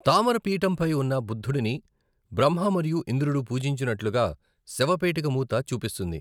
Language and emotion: Telugu, neutral